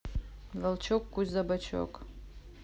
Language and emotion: Russian, neutral